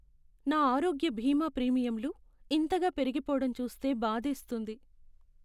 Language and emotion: Telugu, sad